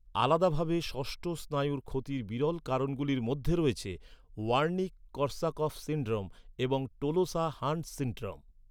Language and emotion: Bengali, neutral